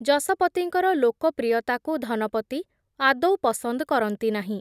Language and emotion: Odia, neutral